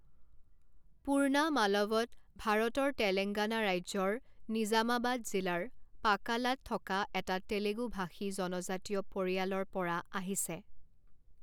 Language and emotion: Assamese, neutral